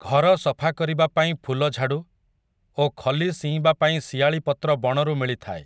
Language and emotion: Odia, neutral